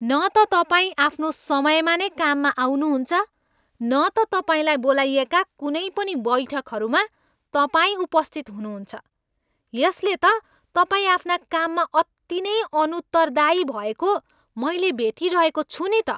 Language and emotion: Nepali, angry